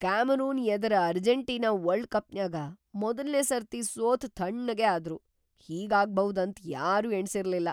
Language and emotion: Kannada, surprised